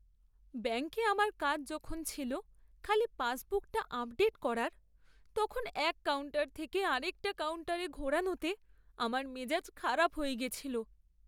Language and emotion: Bengali, sad